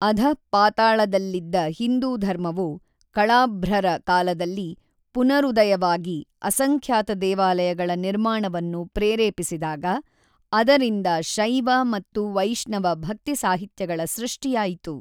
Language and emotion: Kannada, neutral